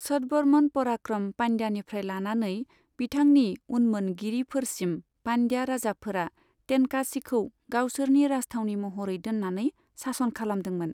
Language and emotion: Bodo, neutral